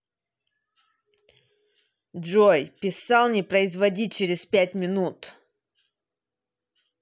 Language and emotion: Russian, angry